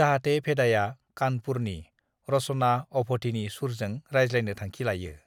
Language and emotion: Bodo, neutral